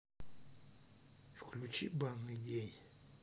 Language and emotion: Russian, neutral